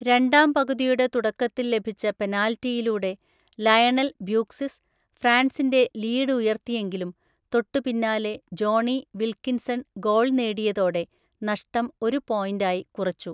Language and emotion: Malayalam, neutral